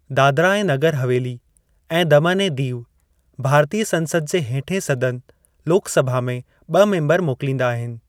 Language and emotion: Sindhi, neutral